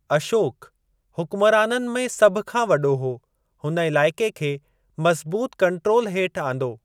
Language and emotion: Sindhi, neutral